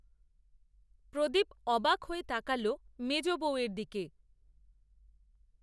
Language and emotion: Bengali, neutral